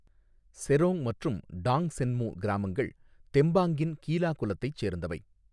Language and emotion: Tamil, neutral